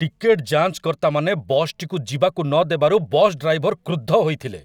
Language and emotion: Odia, angry